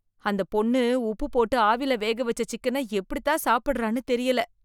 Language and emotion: Tamil, disgusted